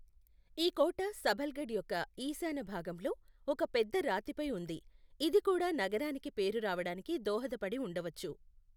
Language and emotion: Telugu, neutral